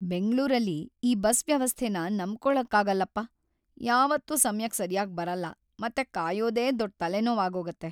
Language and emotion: Kannada, sad